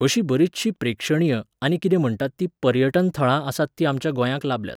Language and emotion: Goan Konkani, neutral